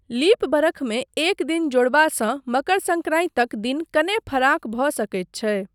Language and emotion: Maithili, neutral